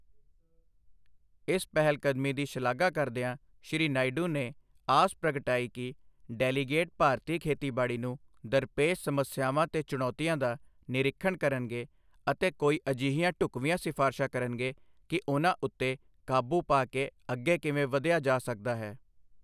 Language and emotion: Punjabi, neutral